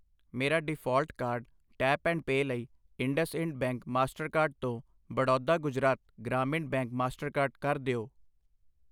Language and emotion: Punjabi, neutral